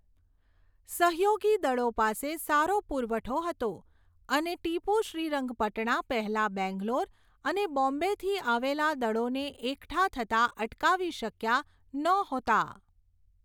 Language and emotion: Gujarati, neutral